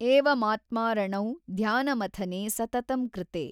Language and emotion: Kannada, neutral